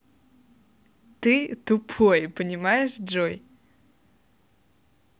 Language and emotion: Russian, positive